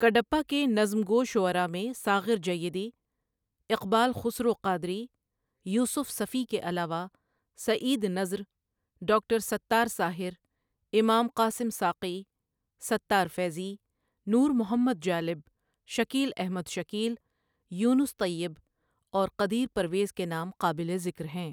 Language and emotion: Urdu, neutral